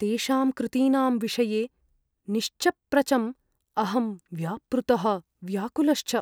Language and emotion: Sanskrit, fearful